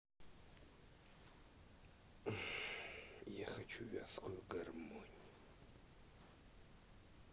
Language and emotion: Russian, sad